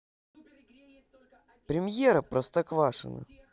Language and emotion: Russian, positive